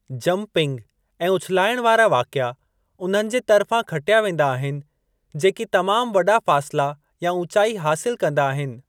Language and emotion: Sindhi, neutral